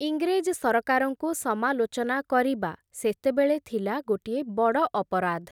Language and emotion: Odia, neutral